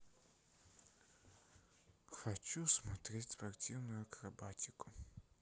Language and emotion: Russian, sad